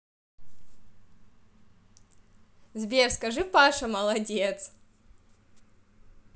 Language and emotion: Russian, positive